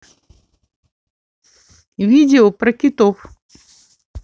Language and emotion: Russian, neutral